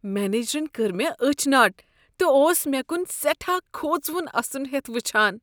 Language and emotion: Kashmiri, disgusted